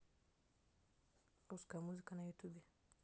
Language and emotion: Russian, neutral